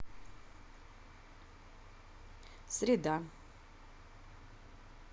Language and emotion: Russian, neutral